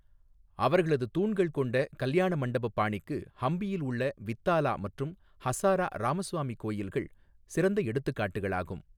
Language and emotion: Tamil, neutral